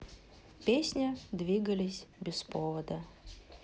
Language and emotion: Russian, neutral